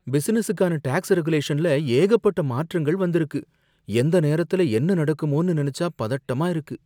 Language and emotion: Tamil, fearful